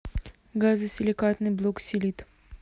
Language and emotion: Russian, neutral